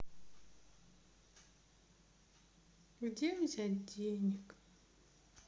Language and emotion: Russian, sad